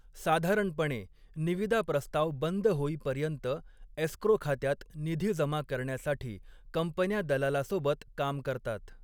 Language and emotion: Marathi, neutral